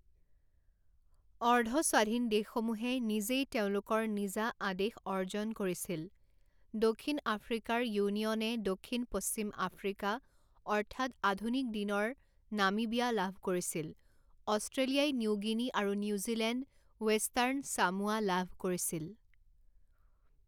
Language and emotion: Assamese, neutral